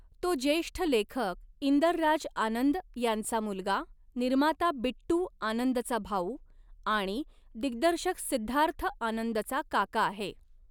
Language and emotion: Marathi, neutral